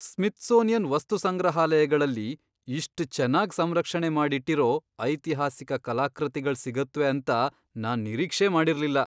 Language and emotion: Kannada, surprised